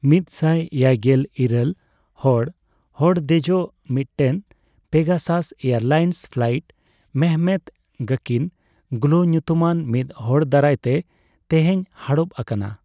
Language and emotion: Santali, neutral